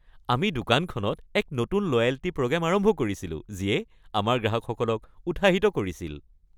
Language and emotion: Assamese, happy